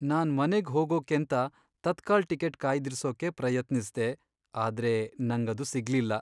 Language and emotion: Kannada, sad